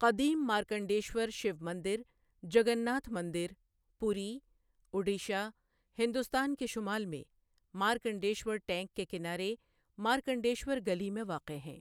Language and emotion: Urdu, neutral